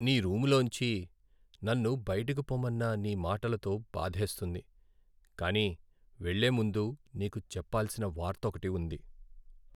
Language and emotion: Telugu, sad